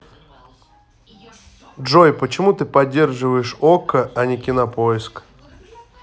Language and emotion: Russian, neutral